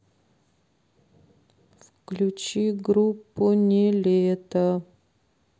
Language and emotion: Russian, sad